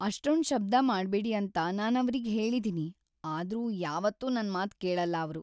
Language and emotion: Kannada, sad